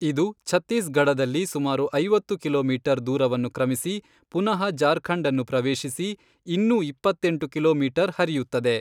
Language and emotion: Kannada, neutral